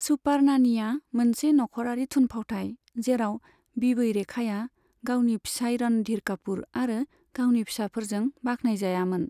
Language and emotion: Bodo, neutral